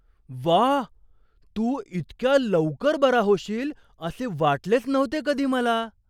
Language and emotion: Marathi, surprised